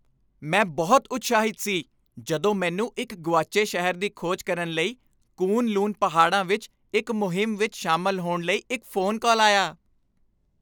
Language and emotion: Punjabi, happy